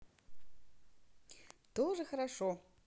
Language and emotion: Russian, positive